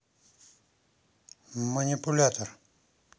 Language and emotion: Russian, neutral